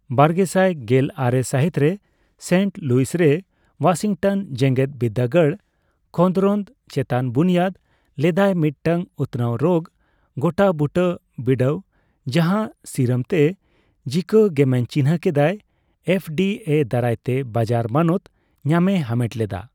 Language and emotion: Santali, neutral